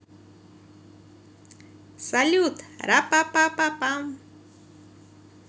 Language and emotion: Russian, positive